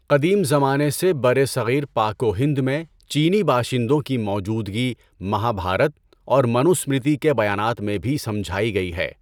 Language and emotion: Urdu, neutral